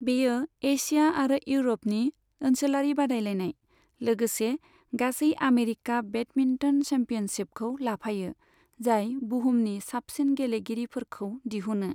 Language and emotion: Bodo, neutral